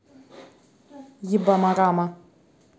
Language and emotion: Russian, angry